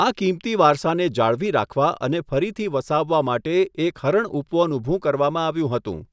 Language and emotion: Gujarati, neutral